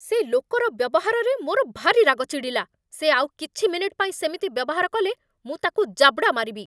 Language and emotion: Odia, angry